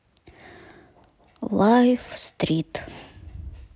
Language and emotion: Russian, neutral